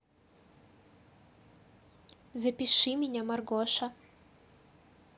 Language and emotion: Russian, neutral